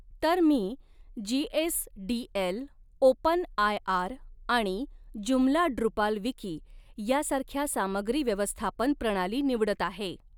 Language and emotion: Marathi, neutral